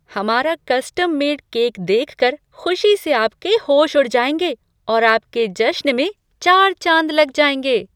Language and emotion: Hindi, surprised